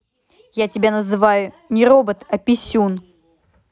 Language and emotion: Russian, angry